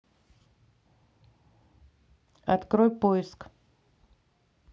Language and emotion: Russian, neutral